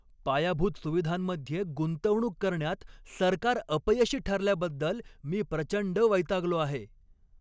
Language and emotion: Marathi, angry